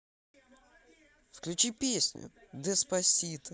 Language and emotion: Russian, positive